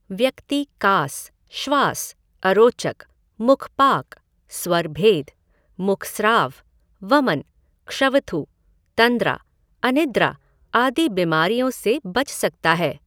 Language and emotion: Hindi, neutral